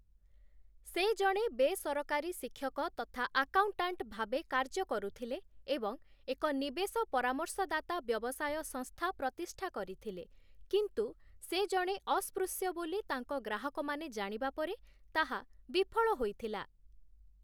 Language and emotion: Odia, neutral